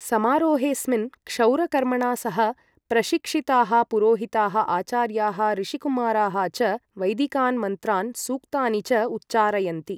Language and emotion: Sanskrit, neutral